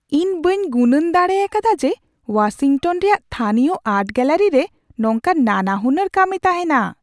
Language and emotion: Santali, surprised